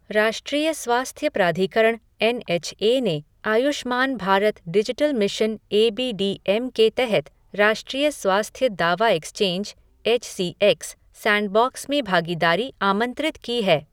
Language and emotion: Hindi, neutral